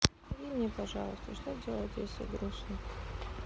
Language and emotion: Russian, sad